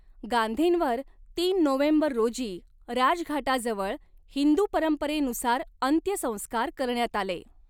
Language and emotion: Marathi, neutral